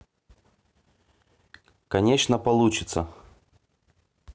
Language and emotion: Russian, neutral